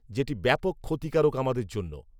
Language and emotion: Bengali, neutral